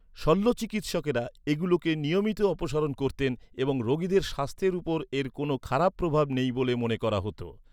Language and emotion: Bengali, neutral